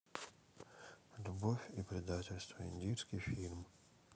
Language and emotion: Russian, sad